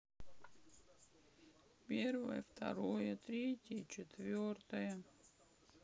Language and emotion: Russian, sad